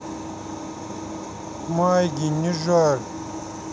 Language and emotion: Russian, sad